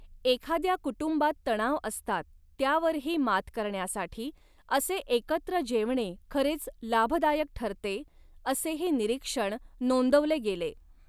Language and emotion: Marathi, neutral